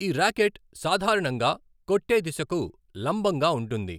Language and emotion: Telugu, neutral